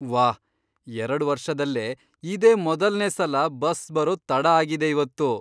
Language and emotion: Kannada, surprised